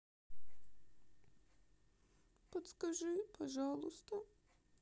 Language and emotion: Russian, sad